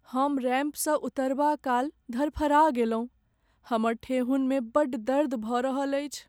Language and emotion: Maithili, sad